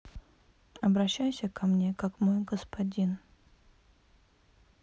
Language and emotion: Russian, neutral